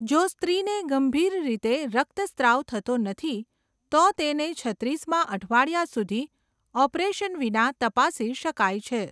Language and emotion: Gujarati, neutral